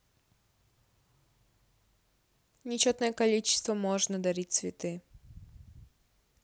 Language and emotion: Russian, neutral